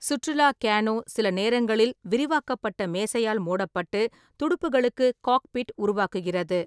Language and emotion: Tamil, neutral